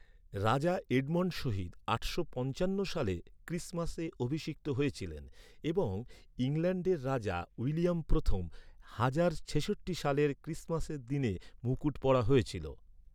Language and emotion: Bengali, neutral